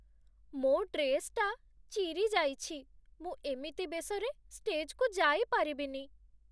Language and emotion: Odia, sad